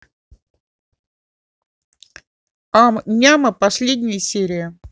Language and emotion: Russian, positive